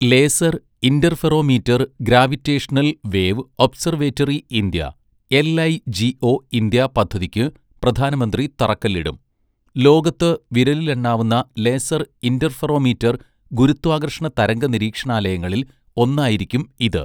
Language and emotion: Malayalam, neutral